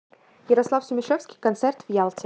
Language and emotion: Russian, neutral